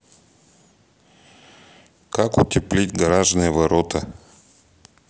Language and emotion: Russian, neutral